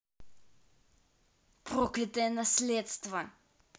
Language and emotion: Russian, angry